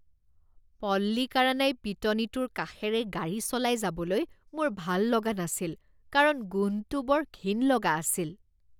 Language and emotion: Assamese, disgusted